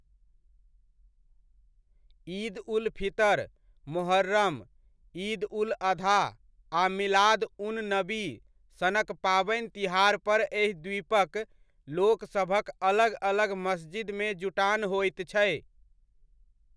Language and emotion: Maithili, neutral